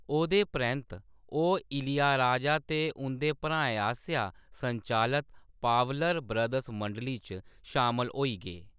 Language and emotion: Dogri, neutral